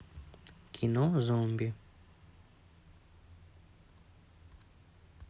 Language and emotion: Russian, neutral